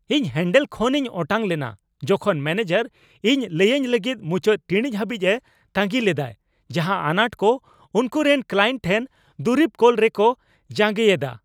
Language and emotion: Santali, angry